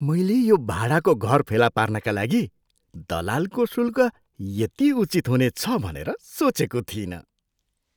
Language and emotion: Nepali, surprised